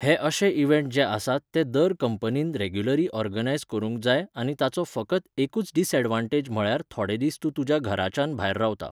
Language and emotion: Goan Konkani, neutral